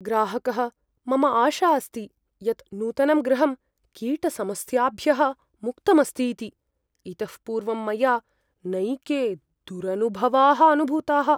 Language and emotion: Sanskrit, fearful